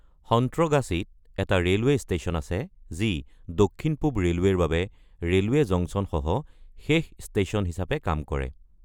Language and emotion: Assamese, neutral